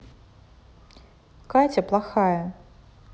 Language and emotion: Russian, neutral